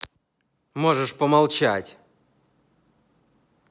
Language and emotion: Russian, angry